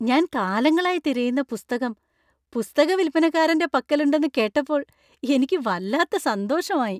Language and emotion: Malayalam, happy